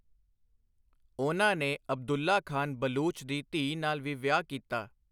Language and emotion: Punjabi, neutral